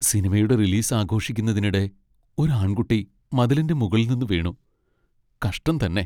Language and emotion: Malayalam, sad